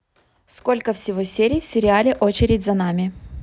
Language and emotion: Russian, neutral